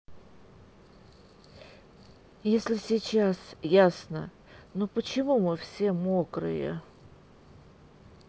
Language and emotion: Russian, sad